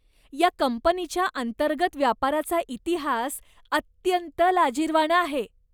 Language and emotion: Marathi, disgusted